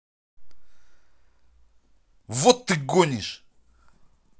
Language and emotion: Russian, angry